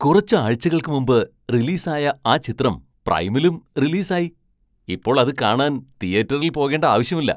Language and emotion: Malayalam, surprised